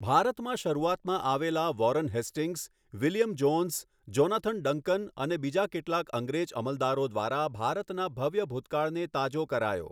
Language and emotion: Gujarati, neutral